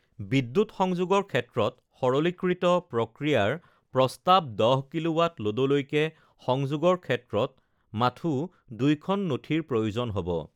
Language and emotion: Assamese, neutral